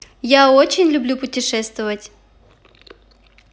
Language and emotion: Russian, positive